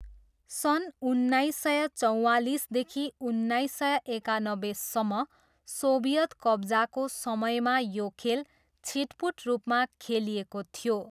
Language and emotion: Nepali, neutral